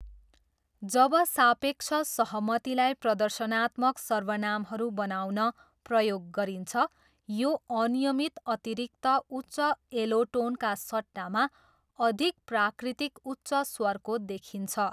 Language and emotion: Nepali, neutral